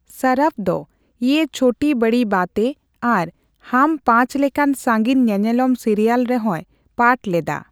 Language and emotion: Santali, neutral